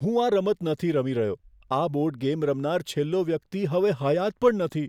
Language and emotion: Gujarati, fearful